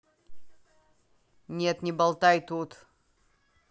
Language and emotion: Russian, angry